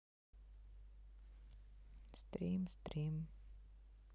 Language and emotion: Russian, sad